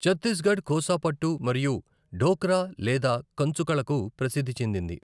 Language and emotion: Telugu, neutral